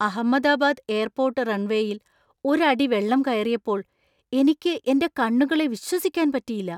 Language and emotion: Malayalam, surprised